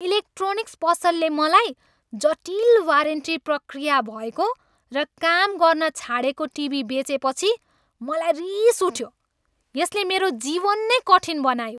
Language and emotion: Nepali, angry